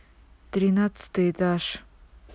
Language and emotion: Russian, neutral